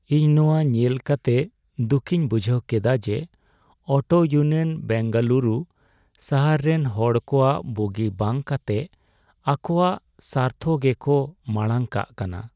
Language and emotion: Santali, sad